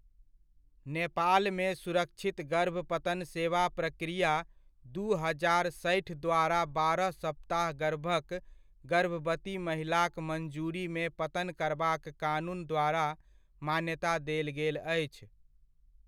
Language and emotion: Maithili, neutral